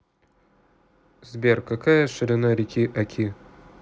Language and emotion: Russian, neutral